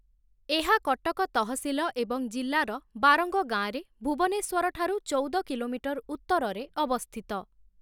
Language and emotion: Odia, neutral